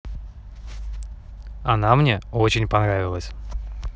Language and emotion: Russian, positive